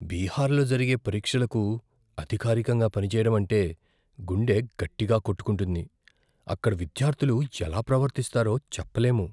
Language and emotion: Telugu, fearful